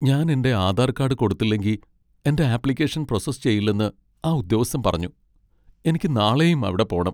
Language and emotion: Malayalam, sad